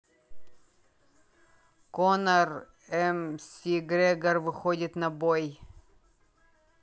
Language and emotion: Russian, neutral